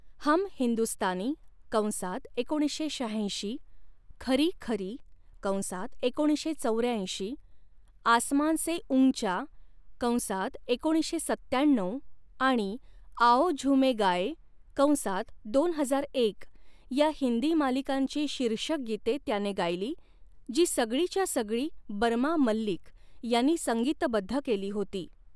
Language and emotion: Marathi, neutral